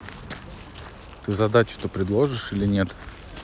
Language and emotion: Russian, neutral